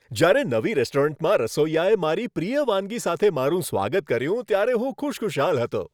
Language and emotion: Gujarati, happy